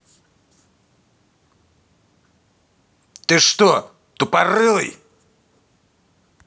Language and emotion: Russian, angry